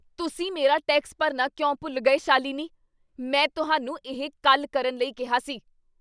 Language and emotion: Punjabi, angry